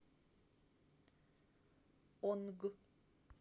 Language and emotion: Russian, neutral